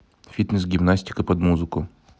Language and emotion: Russian, neutral